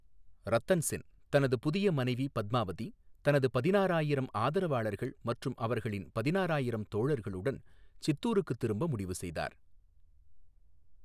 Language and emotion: Tamil, neutral